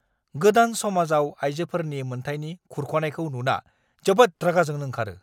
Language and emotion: Bodo, angry